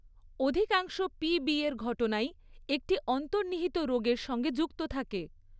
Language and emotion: Bengali, neutral